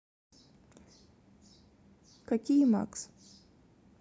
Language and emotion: Russian, neutral